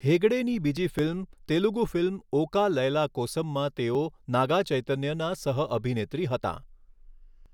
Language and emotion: Gujarati, neutral